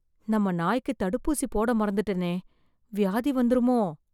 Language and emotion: Tamil, fearful